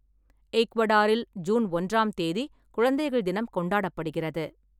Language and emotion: Tamil, neutral